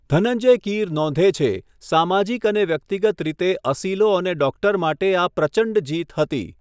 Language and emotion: Gujarati, neutral